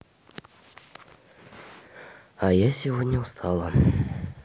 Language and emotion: Russian, sad